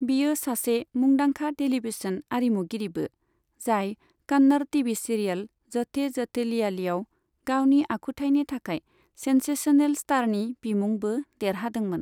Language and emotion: Bodo, neutral